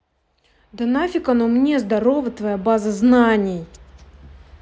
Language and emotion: Russian, angry